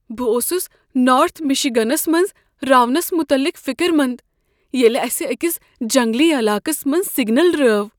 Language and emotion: Kashmiri, fearful